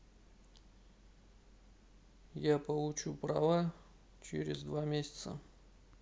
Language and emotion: Russian, neutral